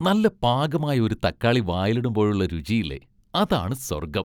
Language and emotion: Malayalam, happy